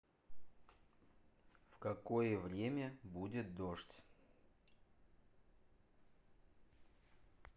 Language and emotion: Russian, neutral